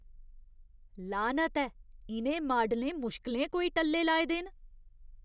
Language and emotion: Dogri, disgusted